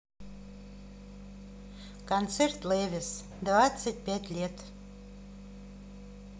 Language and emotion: Russian, neutral